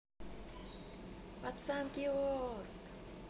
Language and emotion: Russian, positive